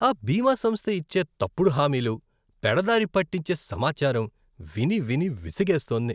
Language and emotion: Telugu, disgusted